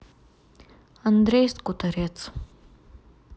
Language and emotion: Russian, sad